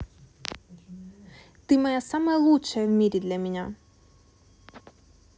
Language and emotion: Russian, positive